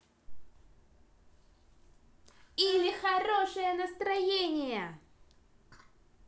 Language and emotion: Russian, positive